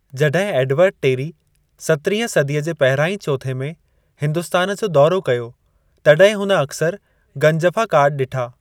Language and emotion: Sindhi, neutral